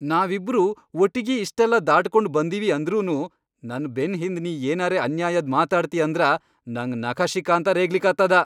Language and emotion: Kannada, angry